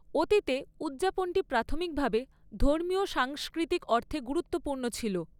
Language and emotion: Bengali, neutral